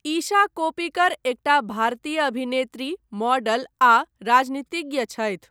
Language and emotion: Maithili, neutral